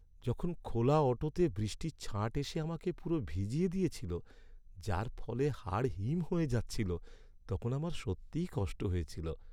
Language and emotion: Bengali, sad